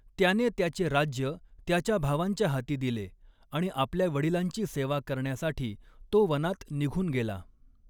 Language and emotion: Marathi, neutral